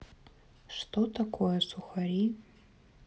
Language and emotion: Russian, neutral